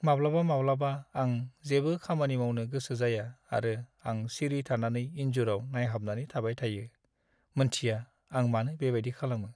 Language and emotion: Bodo, sad